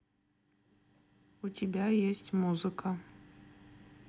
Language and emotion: Russian, neutral